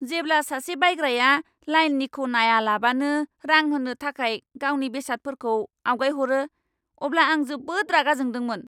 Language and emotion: Bodo, angry